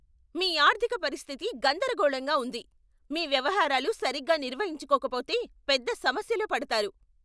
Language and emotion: Telugu, angry